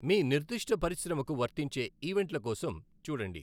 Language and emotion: Telugu, neutral